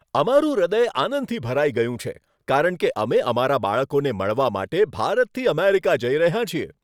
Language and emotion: Gujarati, happy